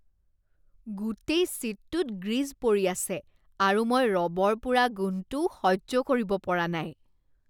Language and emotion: Assamese, disgusted